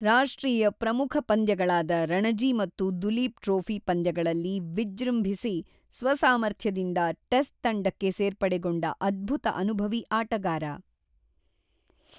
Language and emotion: Kannada, neutral